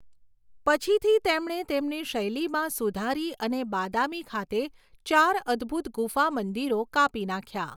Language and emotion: Gujarati, neutral